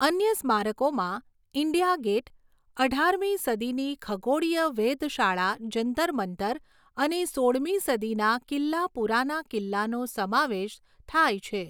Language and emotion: Gujarati, neutral